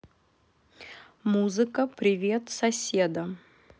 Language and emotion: Russian, neutral